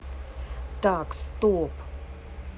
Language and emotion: Russian, neutral